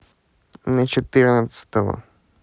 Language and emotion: Russian, neutral